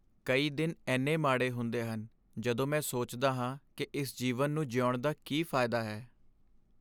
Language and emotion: Punjabi, sad